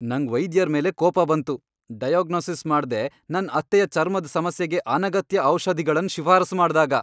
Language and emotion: Kannada, angry